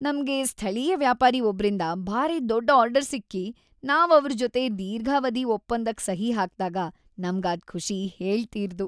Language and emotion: Kannada, happy